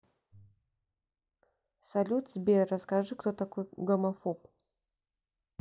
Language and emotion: Russian, neutral